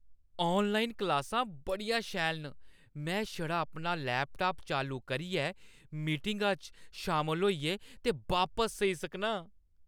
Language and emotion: Dogri, happy